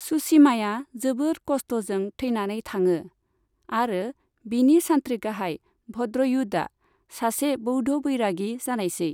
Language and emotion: Bodo, neutral